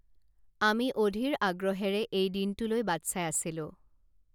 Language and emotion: Assamese, neutral